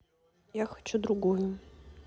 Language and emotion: Russian, neutral